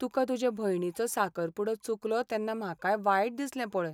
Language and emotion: Goan Konkani, sad